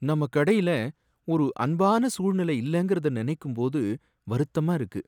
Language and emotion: Tamil, sad